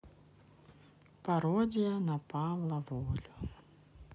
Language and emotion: Russian, sad